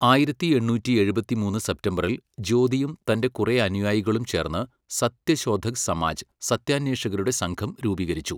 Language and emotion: Malayalam, neutral